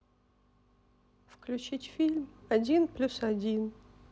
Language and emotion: Russian, sad